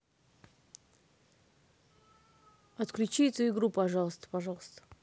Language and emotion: Russian, neutral